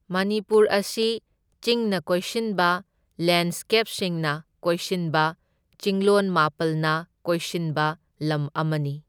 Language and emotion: Manipuri, neutral